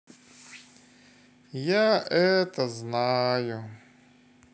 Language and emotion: Russian, sad